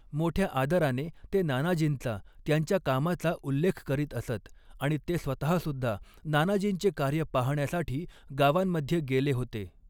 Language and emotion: Marathi, neutral